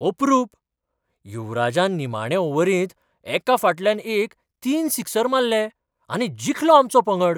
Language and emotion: Goan Konkani, surprised